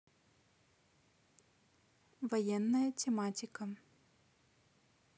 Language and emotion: Russian, neutral